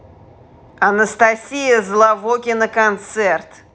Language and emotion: Russian, angry